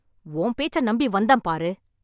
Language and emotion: Tamil, angry